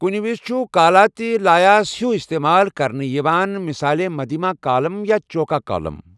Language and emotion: Kashmiri, neutral